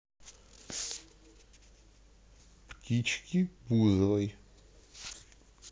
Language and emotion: Russian, neutral